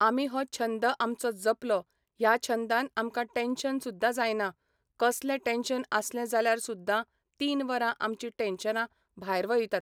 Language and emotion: Goan Konkani, neutral